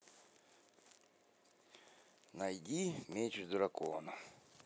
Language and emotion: Russian, neutral